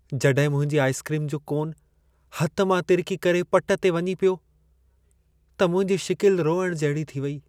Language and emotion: Sindhi, sad